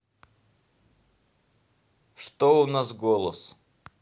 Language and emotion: Russian, neutral